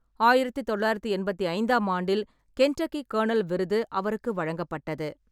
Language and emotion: Tamil, neutral